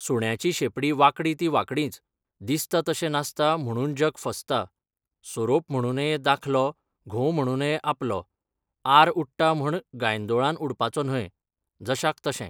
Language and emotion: Goan Konkani, neutral